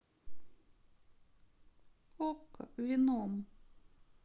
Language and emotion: Russian, sad